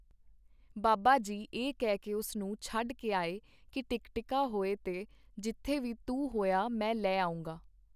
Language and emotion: Punjabi, neutral